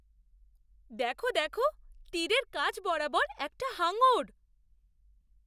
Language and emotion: Bengali, surprised